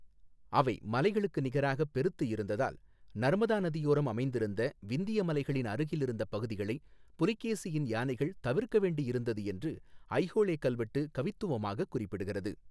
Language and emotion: Tamil, neutral